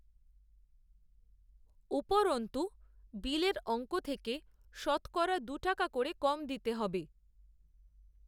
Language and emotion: Bengali, neutral